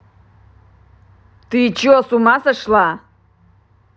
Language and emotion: Russian, angry